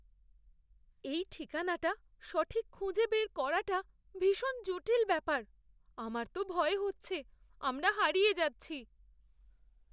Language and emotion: Bengali, fearful